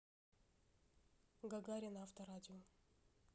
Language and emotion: Russian, neutral